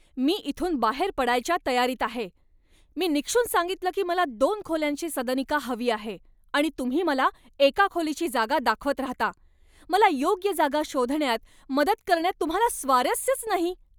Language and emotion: Marathi, angry